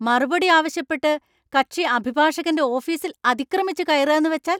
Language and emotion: Malayalam, angry